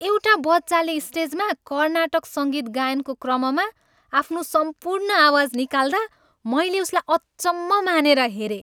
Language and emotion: Nepali, happy